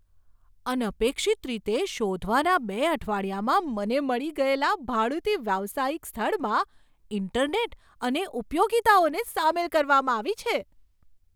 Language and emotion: Gujarati, surprised